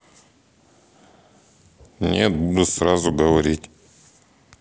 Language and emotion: Russian, neutral